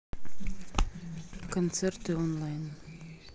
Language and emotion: Russian, neutral